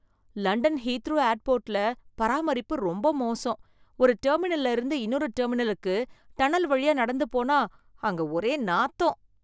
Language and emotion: Tamil, disgusted